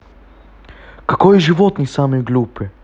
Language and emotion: Russian, neutral